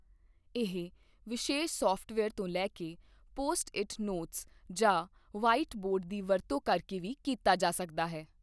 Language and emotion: Punjabi, neutral